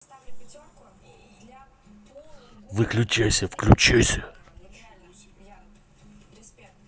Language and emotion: Russian, angry